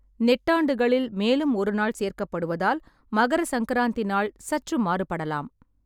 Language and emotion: Tamil, neutral